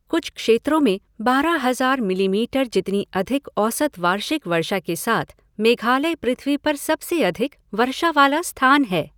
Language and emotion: Hindi, neutral